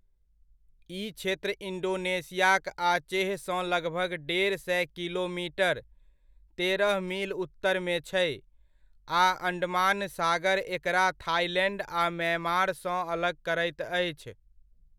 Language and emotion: Maithili, neutral